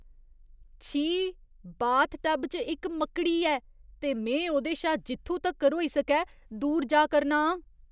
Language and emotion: Dogri, disgusted